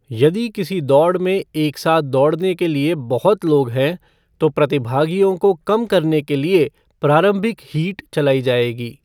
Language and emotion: Hindi, neutral